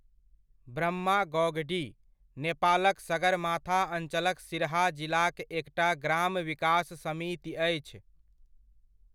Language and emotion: Maithili, neutral